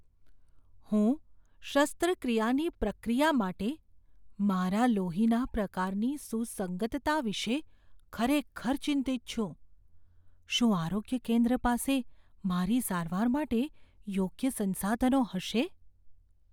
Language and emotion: Gujarati, fearful